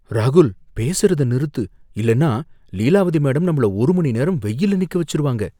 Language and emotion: Tamil, fearful